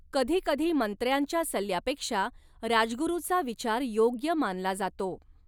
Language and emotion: Marathi, neutral